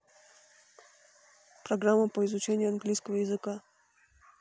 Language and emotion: Russian, neutral